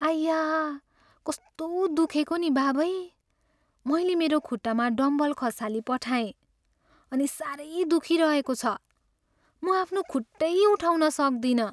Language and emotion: Nepali, sad